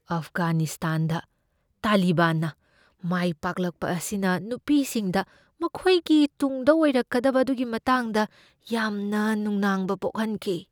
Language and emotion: Manipuri, fearful